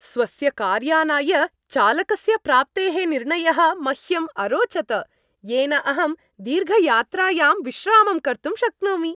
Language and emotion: Sanskrit, happy